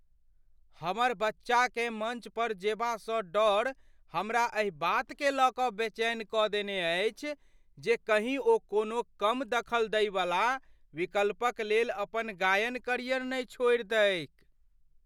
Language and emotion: Maithili, fearful